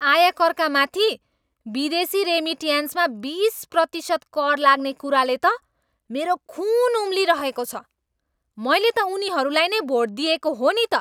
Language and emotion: Nepali, angry